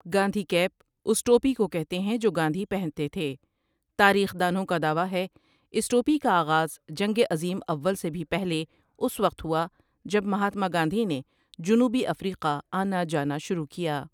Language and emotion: Urdu, neutral